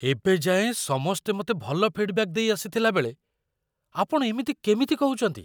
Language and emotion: Odia, surprised